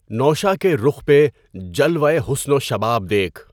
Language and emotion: Urdu, neutral